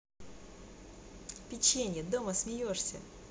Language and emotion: Russian, positive